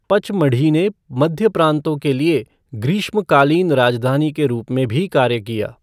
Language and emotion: Hindi, neutral